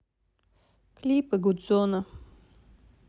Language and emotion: Russian, sad